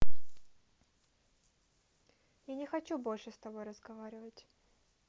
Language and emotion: Russian, neutral